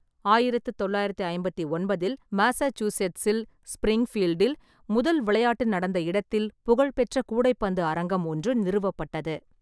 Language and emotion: Tamil, neutral